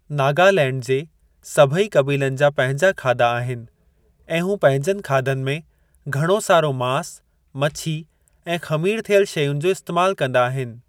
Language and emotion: Sindhi, neutral